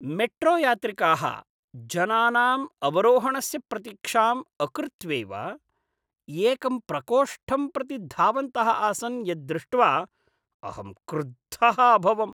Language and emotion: Sanskrit, disgusted